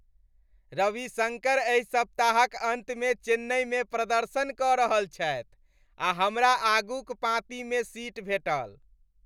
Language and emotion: Maithili, happy